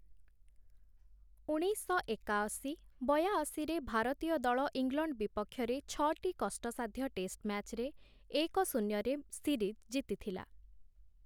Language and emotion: Odia, neutral